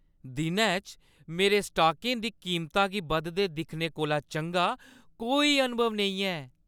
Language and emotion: Dogri, happy